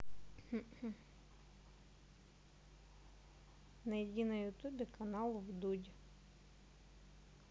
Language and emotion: Russian, neutral